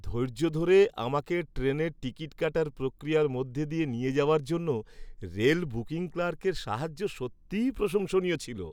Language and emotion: Bengali, happy